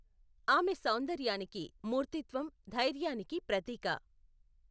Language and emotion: Telugu, neutral